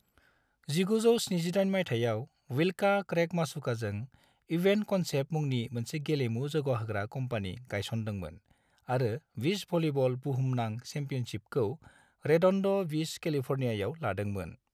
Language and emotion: Bodo, neutral